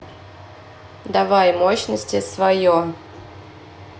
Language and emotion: Russian, neutral